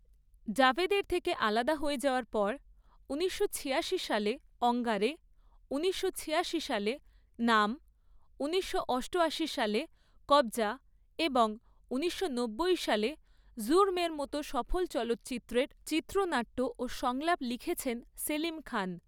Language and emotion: Bengali, neutral